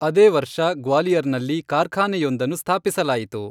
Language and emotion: Kannada, neutral